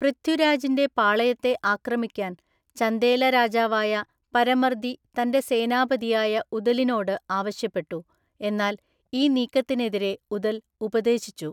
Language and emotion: Malayalam, neutral